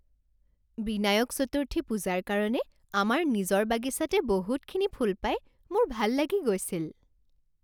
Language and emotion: Assamese, happy